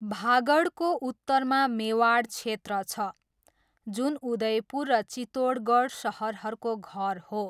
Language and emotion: Nepali, neutral